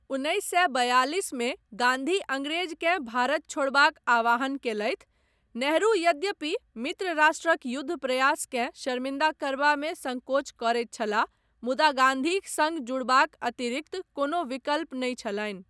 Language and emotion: Maithili, neutral